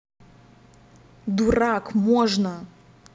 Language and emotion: Russian, angry